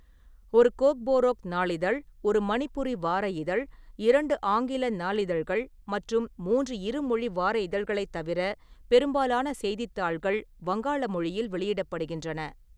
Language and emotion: Tamil, neutral